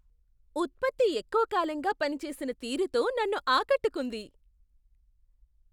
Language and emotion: Telugu, surprised